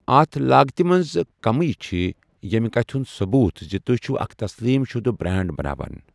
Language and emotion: Kashmiri, neutral